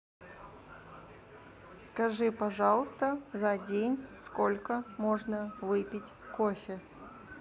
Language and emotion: Russian, neutral